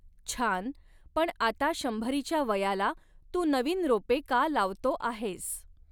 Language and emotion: Marathi, neutral